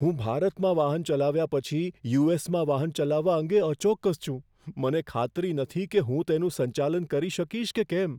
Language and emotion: Gujarati, fearful